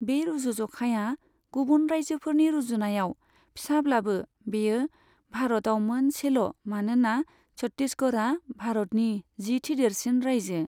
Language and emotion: Bodo, neutral